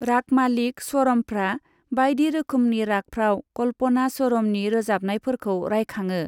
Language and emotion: Bodo, neutral